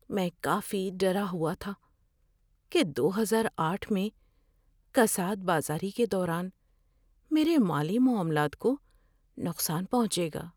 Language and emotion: Urdu, fearful